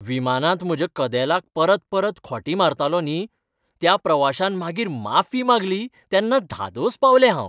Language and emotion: Goan Konkani, happy